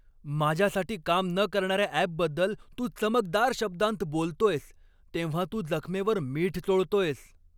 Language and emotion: Marathi, angry